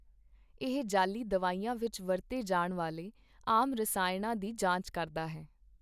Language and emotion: Punjabi, neutral